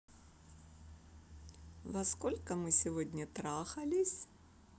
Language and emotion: Russian, positive